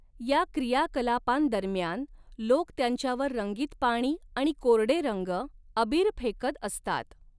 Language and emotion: Marathi, neutral